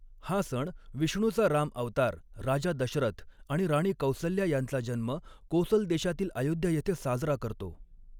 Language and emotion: Marathi, neutral